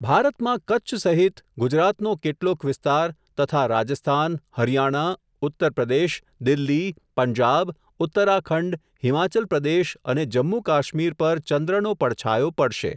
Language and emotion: Gujarati, neutral